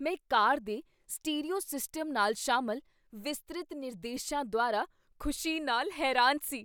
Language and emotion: Punjabi, surprised